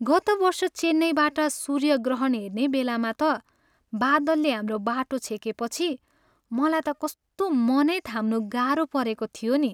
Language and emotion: Nepali, sad